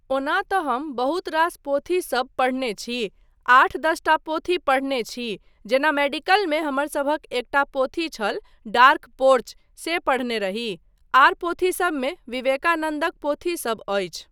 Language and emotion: Maithili, neutral